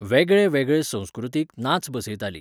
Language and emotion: Goan Konkani, neutral